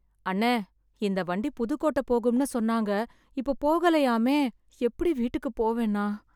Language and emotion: Tamil, sad